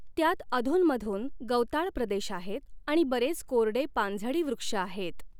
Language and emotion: Marathi, neutral